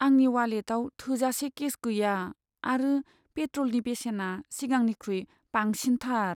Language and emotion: Bodo, sad